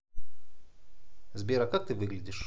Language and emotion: Russian, neutral